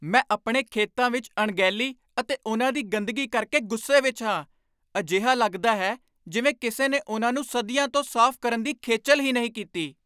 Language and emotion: Punjabi, angry